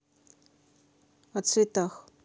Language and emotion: Russian, neutral